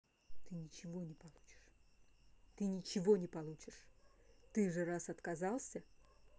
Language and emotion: Russian, angry